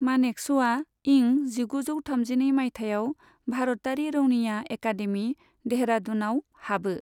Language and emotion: Bodo, neutral